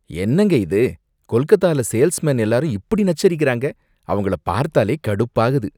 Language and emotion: Tamil, disgusted